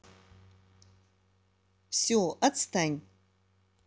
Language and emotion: Russian, positive